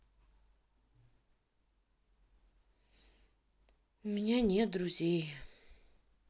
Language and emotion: Russian, sad